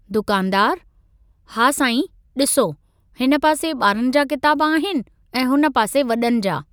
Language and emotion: Sindhi, neutral